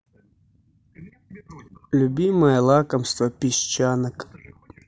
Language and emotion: Russian, neutral